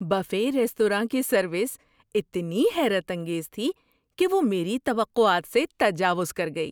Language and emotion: Urdu, surprised